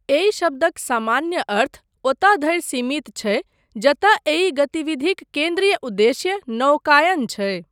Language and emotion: Maithili, neutral